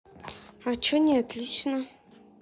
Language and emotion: Russian, neutral